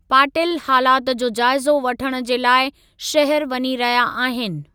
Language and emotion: Sindhi, neutral